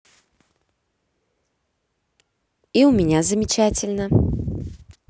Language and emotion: Russian, positive